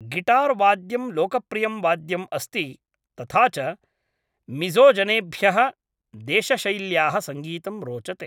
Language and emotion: Sanskrit, neutral